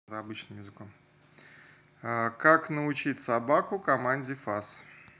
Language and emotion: Russian, neutral